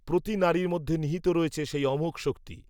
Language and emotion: Bengali, neutral